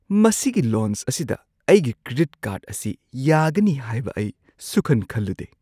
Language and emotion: Manipuri, surprised